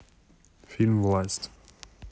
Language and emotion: Russian, neutral